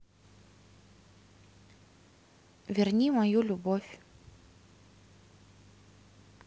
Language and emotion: Russian, neutral